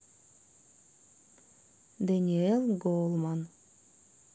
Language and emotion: Russian, neutral